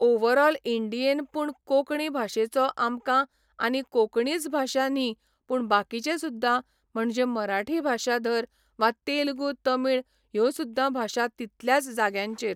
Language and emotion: Goan Konkani, neutral